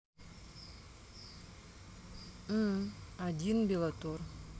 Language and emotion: Russian, neutral